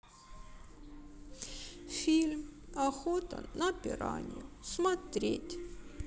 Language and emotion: Russian, sad